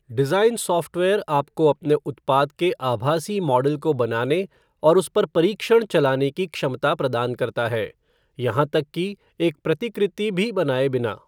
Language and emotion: Hindi, neutral